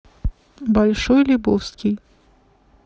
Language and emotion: Russian, neutral